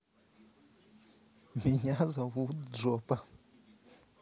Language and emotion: Russian, positive